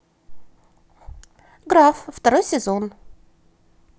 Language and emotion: Russian, positive